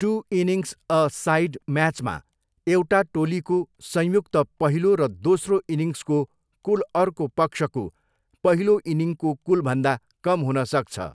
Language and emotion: Nepali, neutral